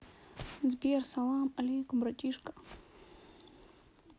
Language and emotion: Russian, sad